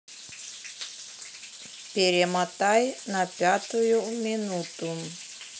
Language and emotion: Russian, neutral